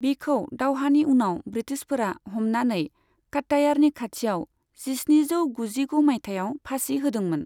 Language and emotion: Bodo, neutral